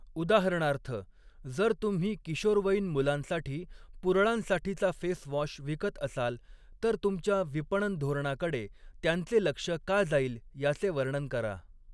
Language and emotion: Marathi, neutral